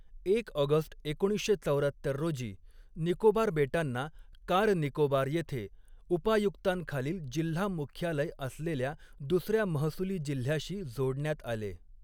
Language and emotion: Marathi, neutral